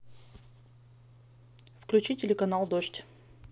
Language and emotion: Russian, neutral